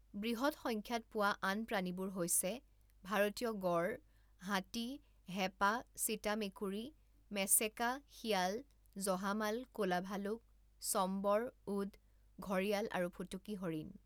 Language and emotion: Assamese, neutral